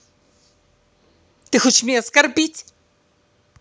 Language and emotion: Russian, angry